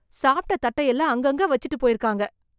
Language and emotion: Tamil, disgusted